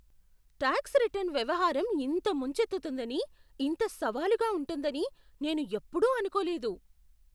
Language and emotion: Telugu, surprised